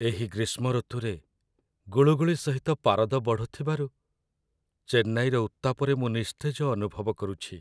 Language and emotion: Odia, sad